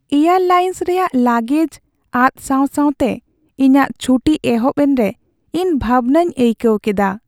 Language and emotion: Santali, sad